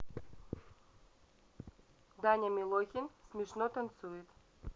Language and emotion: Russian, neutral